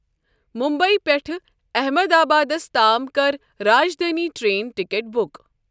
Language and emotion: Kashmiri, neutral